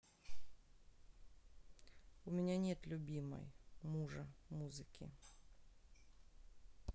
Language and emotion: Russian, sad